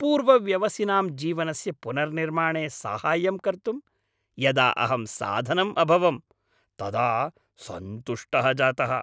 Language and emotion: Sanskrit, happy